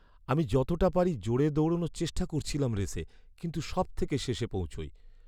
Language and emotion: Bengali, sad